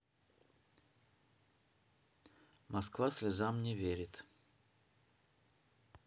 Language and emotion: Russian, neutral